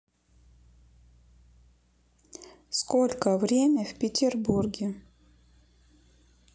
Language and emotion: Russian, neutral